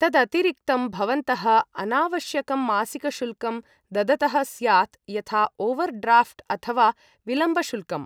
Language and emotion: Sanskrit, neutral